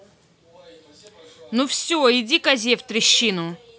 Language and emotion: Russian, angry